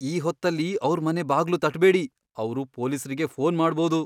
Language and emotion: Kannada, fearful